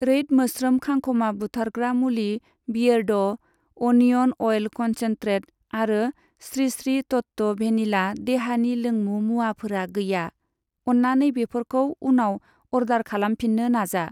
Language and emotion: Bodo, neutral